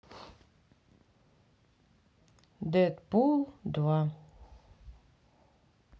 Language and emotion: Russian, neutral